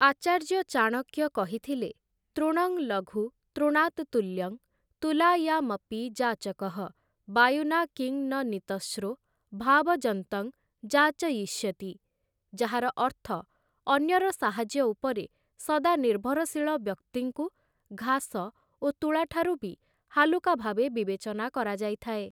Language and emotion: Odia, neutral